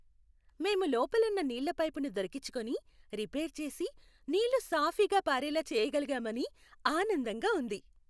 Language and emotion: Telugu, happy